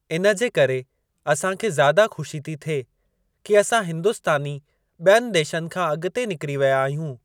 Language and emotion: Sindhi, neutral